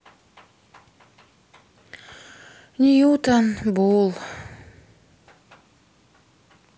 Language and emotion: Russian, sad